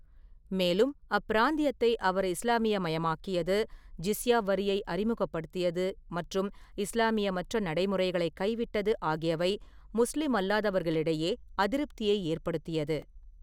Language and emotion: Tamil, neutral